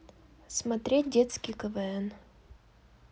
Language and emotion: Russian, neutral